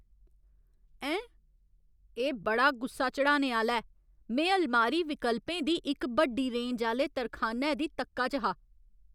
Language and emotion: Dogri, angry